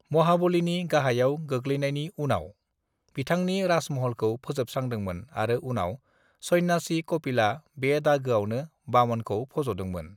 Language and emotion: Bodo, neutral